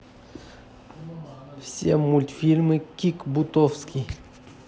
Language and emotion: Russian, neutral